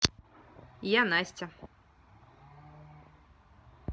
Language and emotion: Russian, positive